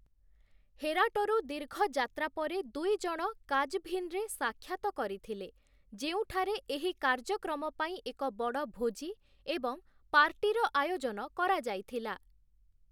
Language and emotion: Odia, neutral